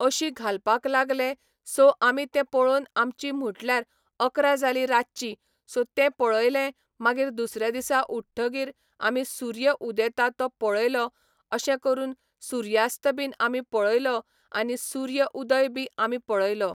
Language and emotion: Goan Konkani, neutral